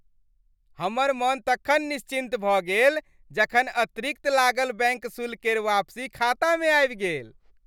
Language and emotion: Maithili, happy